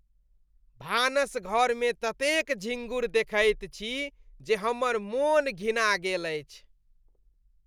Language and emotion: Maithili, disgusted